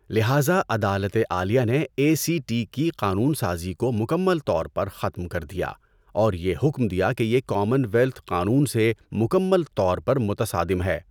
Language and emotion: Urdu, neutral